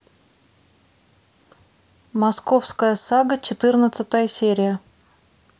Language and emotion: Russian, neutral